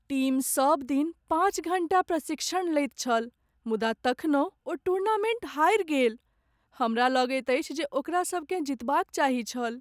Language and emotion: Maithili, sad